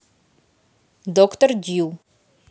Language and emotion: Russian, neutral